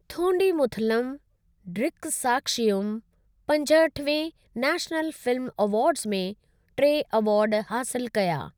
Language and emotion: Sindhi, neutral